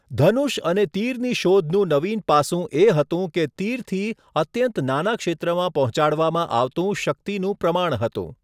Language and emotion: Gujarati, neutral